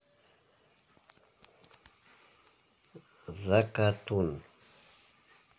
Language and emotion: Russian, neutral